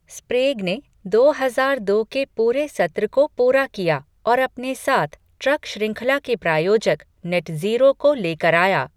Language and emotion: Hindi, neutral